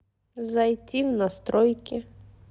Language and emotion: Russian, neutral